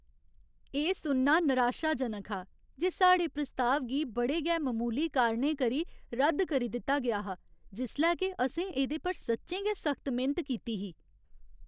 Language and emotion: Dogri, sad